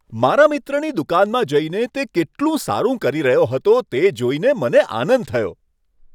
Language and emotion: Gujarati, happy